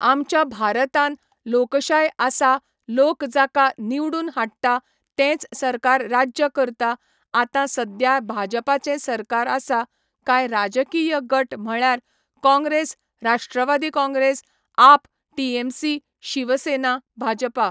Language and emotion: Goan Konkani, neutral